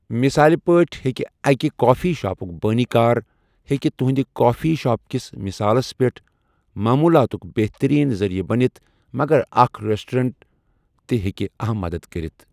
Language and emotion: Kashmiri, neutral